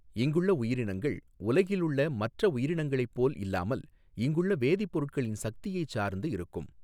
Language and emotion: Tamil, neutral